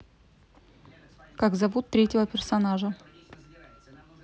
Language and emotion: Russian, neutral